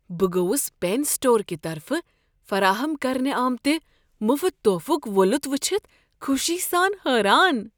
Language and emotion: Kashmiri, surprised